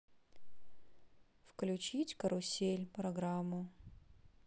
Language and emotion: Russian, sad